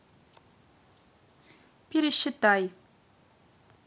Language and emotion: Russian, neutral